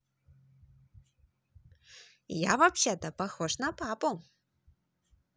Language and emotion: Russian, positive